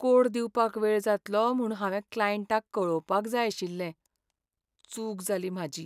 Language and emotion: Goan Konkani, sad